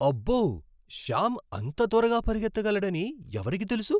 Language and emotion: Telugu, surprised